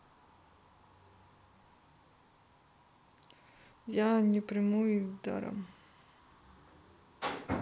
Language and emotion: Russian, sad